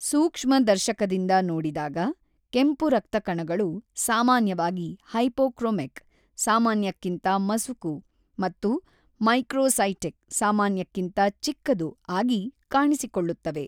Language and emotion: Kannada, neutral